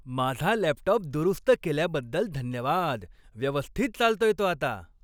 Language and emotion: Marathi, happy